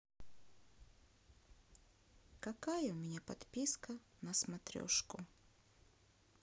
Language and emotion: Russian, sad